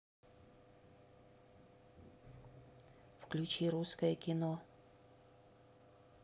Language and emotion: Russian, neutral